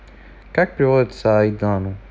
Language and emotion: Russian, neutral